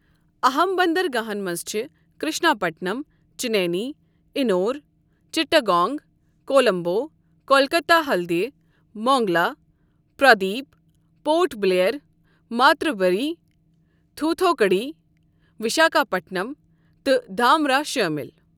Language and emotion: Kashmiri, neutral